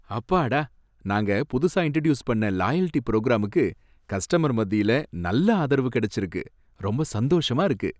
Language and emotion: Tamil, happy